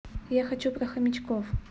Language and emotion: Russian, neutral